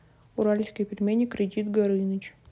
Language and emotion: Russian, neutral